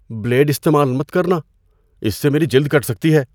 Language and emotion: Urdu, fearful